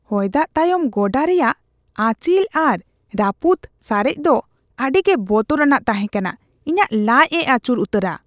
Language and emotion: Santali, disgusted